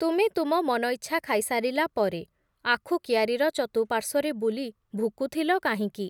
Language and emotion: Odia, neutral